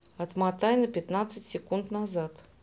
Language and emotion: Russian, neutral